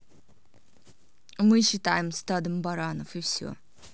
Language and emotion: Russian, neutral